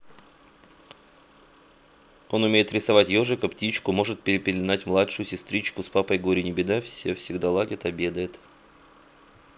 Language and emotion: Russian, neutral